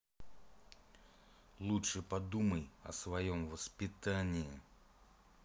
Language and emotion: Russian, angry